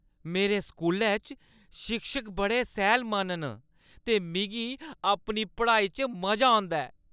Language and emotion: Dogri, happy